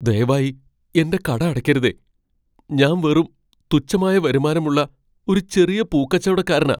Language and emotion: Malayalam, fearful